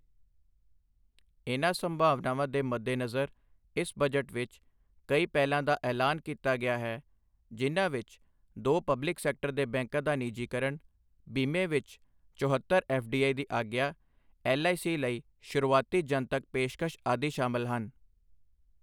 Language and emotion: Punjabi, neutral